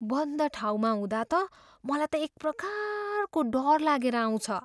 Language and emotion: Nepali, fearful